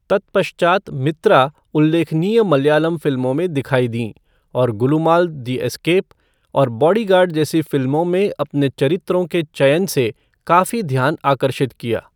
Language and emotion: Hindi, neutral